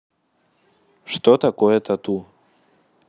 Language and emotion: Russian, neutral